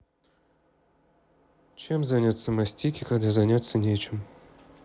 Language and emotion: Russian, neutral